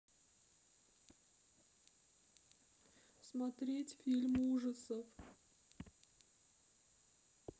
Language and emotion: Russian, sad